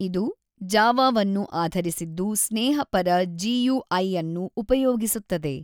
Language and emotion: Kannada, neutral